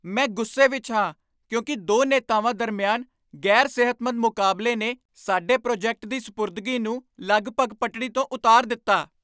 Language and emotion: Punjabi, angry